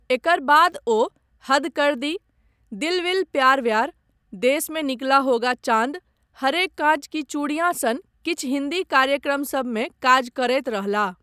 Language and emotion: Maithili, neutral